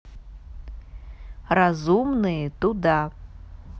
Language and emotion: Russian, neutral